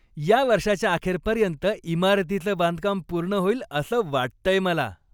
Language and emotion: Marathi, happy